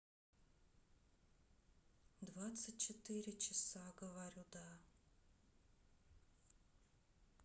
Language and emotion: Russian, neutral